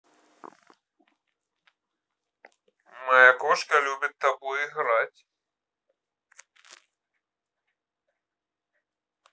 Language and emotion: Russian, neutral